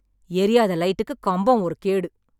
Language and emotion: Tamil, angry